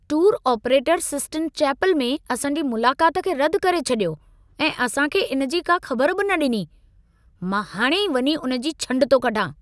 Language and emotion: Sindhi, angry